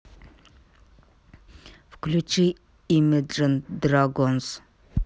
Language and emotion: Russian, neutral